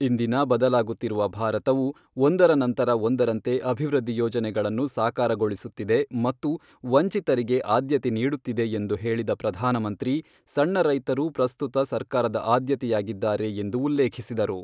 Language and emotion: Kannada, neutral